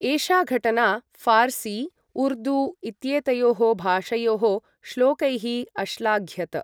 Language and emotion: Sanskrit, neutral